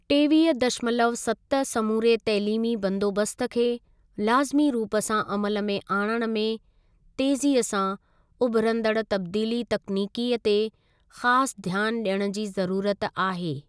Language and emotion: Sindhi, neutral